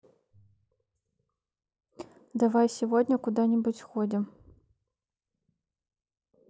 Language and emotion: Russian, neutral